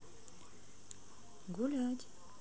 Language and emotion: Russian, neutral